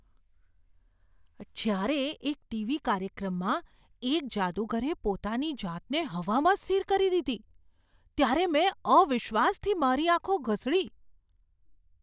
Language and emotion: Gujarati, surprised